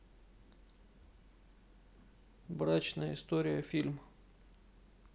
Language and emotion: Russian, neutral